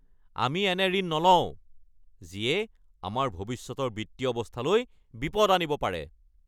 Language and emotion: Assamese, angry